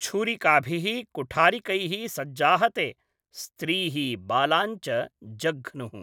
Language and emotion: Sanskrit, neutral